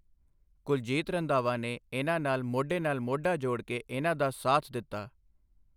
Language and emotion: Punjabi, neutral